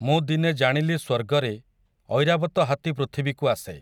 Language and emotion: Odia, neutral